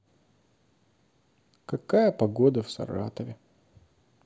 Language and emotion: Russian, sad